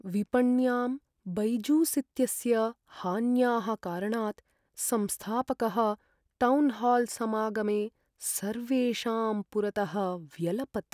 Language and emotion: Sanskrit, sad